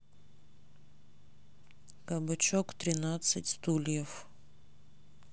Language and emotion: Russian, neutral